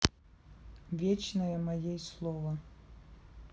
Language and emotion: Russian, neutral